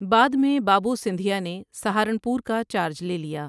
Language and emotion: Urdu, neutral